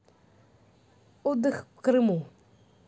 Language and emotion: Russian, neutral